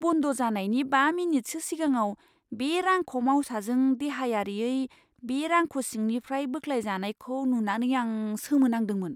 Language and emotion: Bodo, surprised